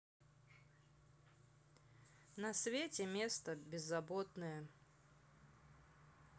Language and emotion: Russian, neutral